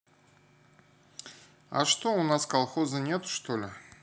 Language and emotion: Russian, neutral